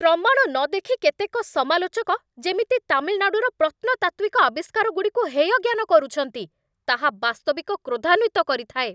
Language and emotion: Odia, angry